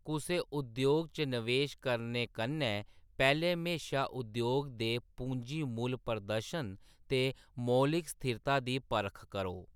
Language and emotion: Dogri, neutral